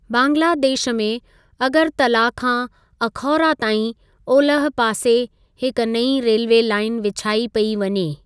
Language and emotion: Sindhi, neutral